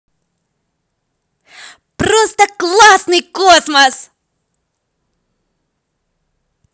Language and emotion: Russian, positive